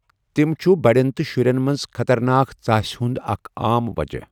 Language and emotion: Kashmiri, neutral